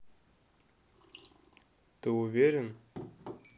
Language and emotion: Russian, neutral